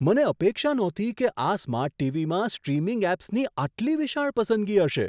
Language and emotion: Gujarati, surprised